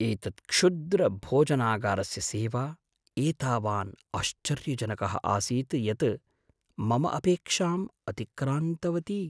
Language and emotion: Sanskrit, surprised